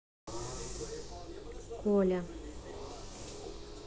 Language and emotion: Russian, neutral